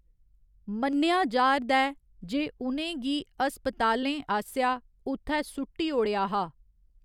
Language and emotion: Dogri, neutral